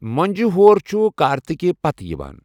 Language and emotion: Kashmiri, neutral